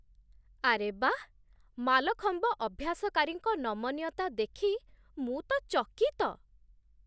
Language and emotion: Odia, surprised